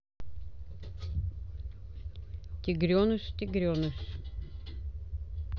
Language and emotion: Russian, neutral